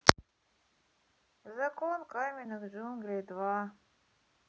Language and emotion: Russian, sad